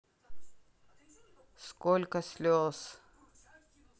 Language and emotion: Russian, neutral